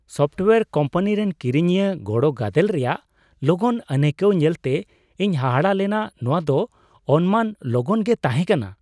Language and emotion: Santali, surprised